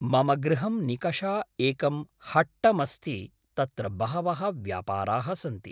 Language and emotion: Sanskrit, neutral